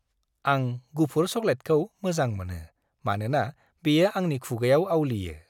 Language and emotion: Bodo, happy